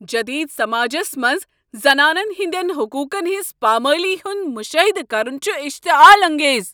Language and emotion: Kashmiri, angry